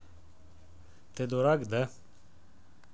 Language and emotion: Russian, neutral